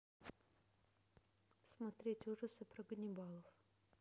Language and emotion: Russian, neutral